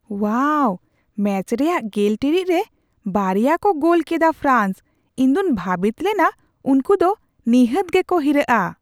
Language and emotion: Santali, surprised